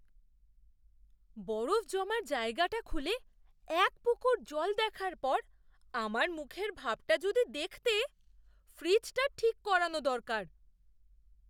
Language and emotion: Bengali, surprised